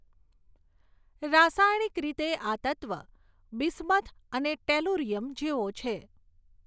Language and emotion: Gujarati, neutral